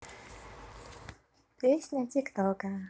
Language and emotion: Russian, neutral